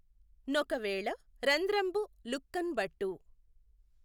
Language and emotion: Telugu, neutral